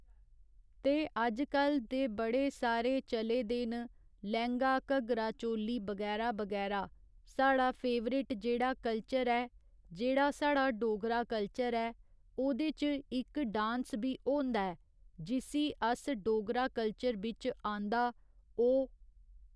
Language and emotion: Dogri, neutral